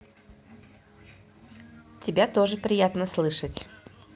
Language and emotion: Russian, positive